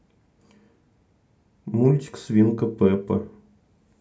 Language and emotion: Russian, neutral